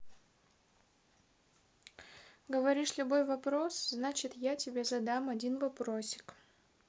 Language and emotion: Russian, neutral